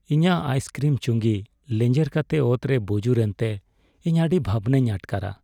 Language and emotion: Santali, sad